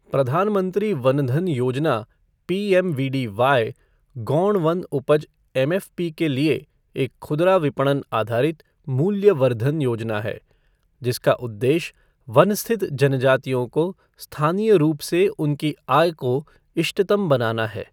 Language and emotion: Hindi, neutral